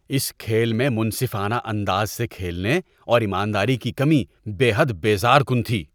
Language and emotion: Urdu, disgusted